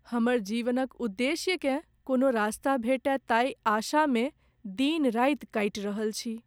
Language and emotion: Maithili, sad